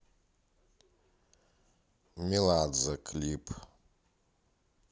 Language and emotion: Russian, neutral